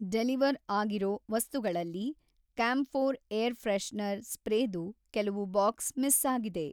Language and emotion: Kannada, neutral